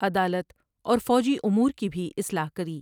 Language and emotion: Urdu, neutral